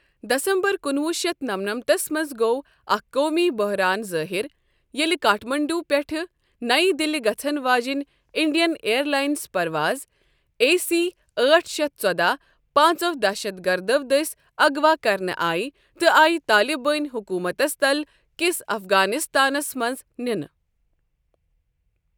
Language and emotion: Kashmiri, neutral